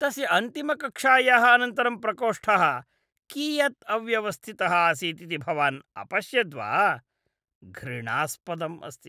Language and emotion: Sanskrit, disgusted